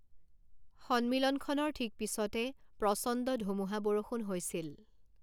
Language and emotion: Assamese, neutral